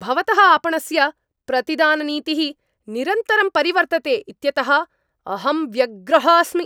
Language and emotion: Sanskrit, angry